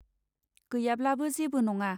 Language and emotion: Bodo, neutral